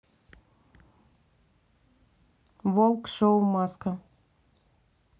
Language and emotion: Russian, neutral